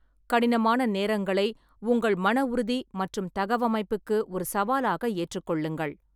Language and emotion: Tamil, neutral